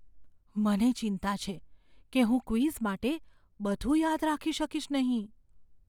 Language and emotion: Gujarati, fearful